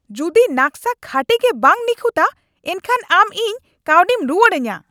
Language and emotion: Santali, angry